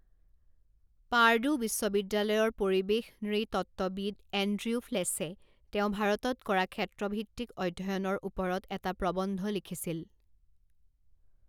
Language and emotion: Assamese, neutral